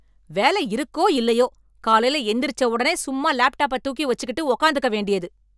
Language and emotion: Tamil, angry